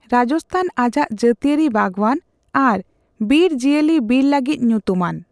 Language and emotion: Santali, neutral